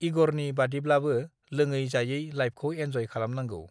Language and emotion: Bodo, neutral